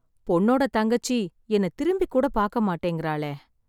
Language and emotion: Tamil, sad